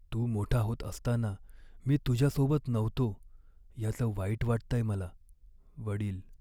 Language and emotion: Marathi, sad